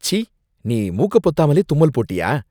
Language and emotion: Tamil, disgusted